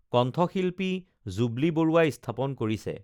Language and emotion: Assamese, neutral